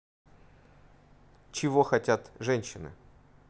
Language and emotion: Russian, neutral